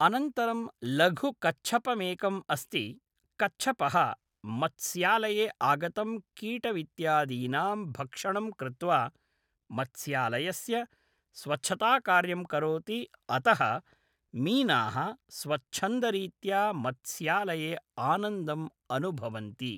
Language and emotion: Sanskrit, neutral